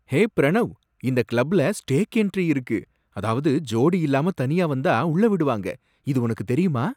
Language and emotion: Tamil, surprised